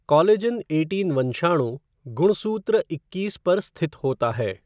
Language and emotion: Hindi, neutral